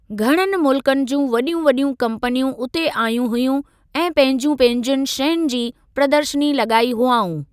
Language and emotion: Sindhi, neutral